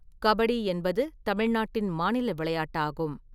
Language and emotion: Tamil, neutral